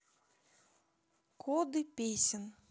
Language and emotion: Russian, neutral